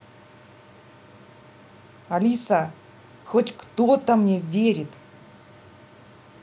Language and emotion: Russian, neutral